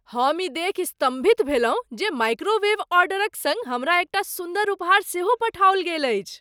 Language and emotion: Maithili, surprised